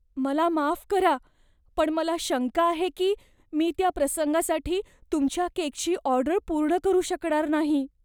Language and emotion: Marathi, fearful